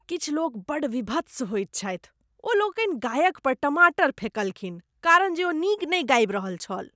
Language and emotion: Maithili, disgusted